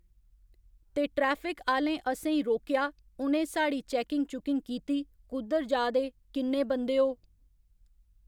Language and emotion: Dogri, neutral